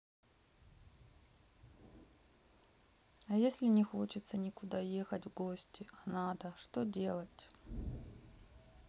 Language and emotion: Russian, sad